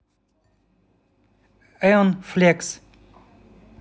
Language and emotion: Russian, neutral